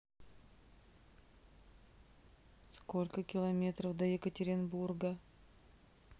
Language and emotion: Russian, neutral